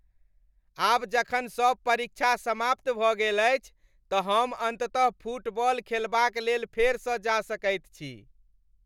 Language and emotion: Maithili, happy